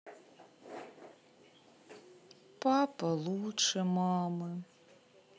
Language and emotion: Russian, sad